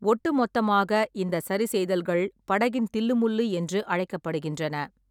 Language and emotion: Tamil, neutral